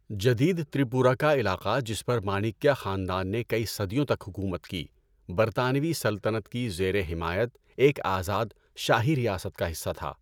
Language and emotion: Urdu, neutral